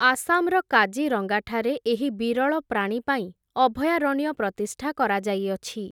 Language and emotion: Odia, neutral